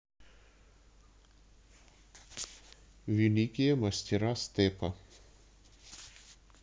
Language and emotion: Russian, neutral